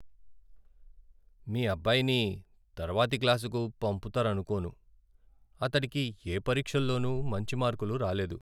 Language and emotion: Telugu, sad